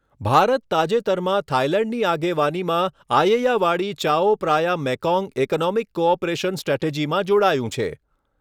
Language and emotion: Gujarati, neutral